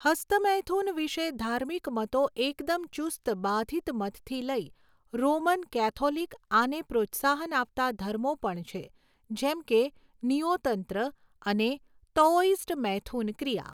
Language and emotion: Gujarati, neutral